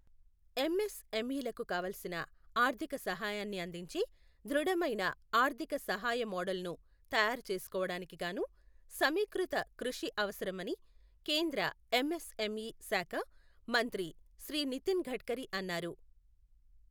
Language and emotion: Telugu, neutral